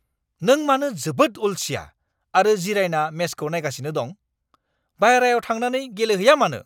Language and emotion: Bodo, angry